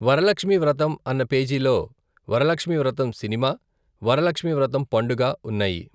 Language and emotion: Telugu, neutral